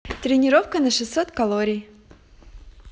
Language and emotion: Russian, positive